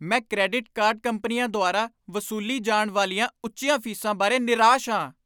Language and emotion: Punjabi, angry